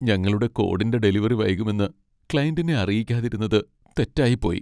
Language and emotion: Malayalam, sad